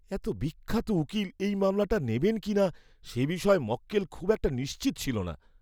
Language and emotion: Bengali, fearful